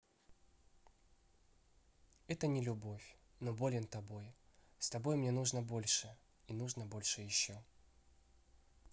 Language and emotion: Russian, neutral